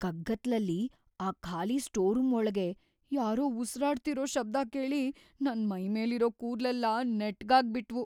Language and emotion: Kannada, fearful